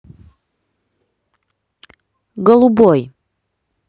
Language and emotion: Russian, neutral